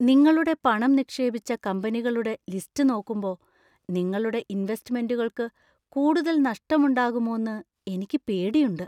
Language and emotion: Malayalam, fearful